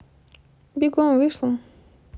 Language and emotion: Russian, neutral